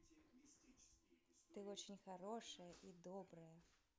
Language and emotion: Russian, positive